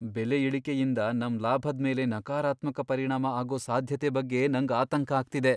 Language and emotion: Kannada, fearful